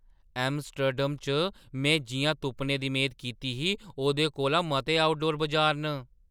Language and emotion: Dogri, surprised